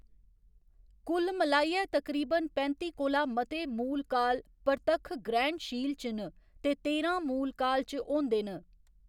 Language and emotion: Dogri, neutral